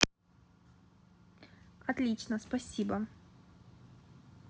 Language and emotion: Russian, neutral